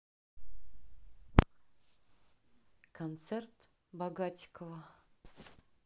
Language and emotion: Russian, neutral